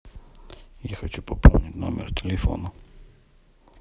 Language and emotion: Russian, neutral